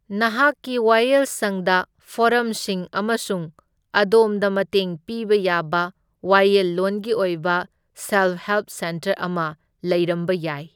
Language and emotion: Manipuri, neutral